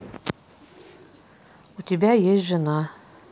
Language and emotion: Russian, neutral